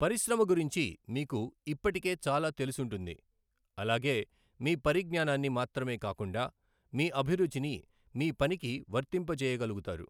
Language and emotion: Telugu, neutral